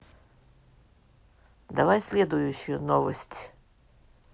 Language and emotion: Russian, neutral